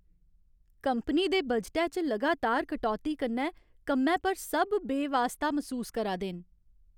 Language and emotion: Dogri, sad